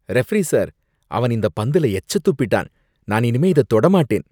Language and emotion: Tamil, disgusted